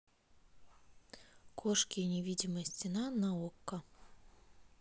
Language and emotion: Russian, neutral